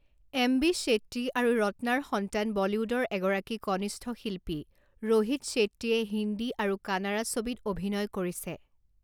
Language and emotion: Assamese, neutral